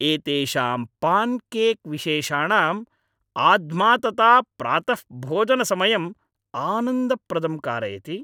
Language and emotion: Sanskrit, happy